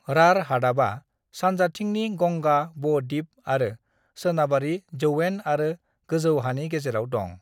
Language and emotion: Bodo, neutral